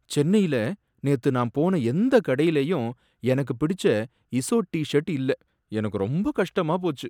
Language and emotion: Tamil, sad